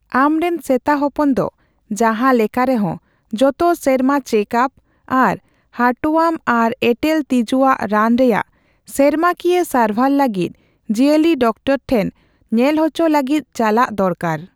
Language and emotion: Santali, neutral